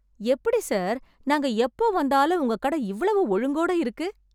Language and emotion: Tamil, surprised